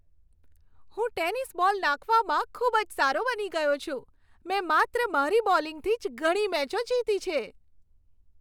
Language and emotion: Gujarati, happy